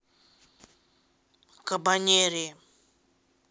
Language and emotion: Russian, neutral